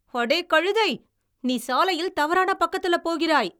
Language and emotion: Tamil, angry